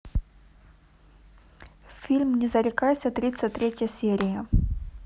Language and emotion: Russian, neutral